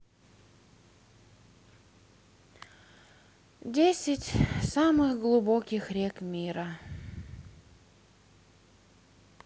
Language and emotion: Russian, sad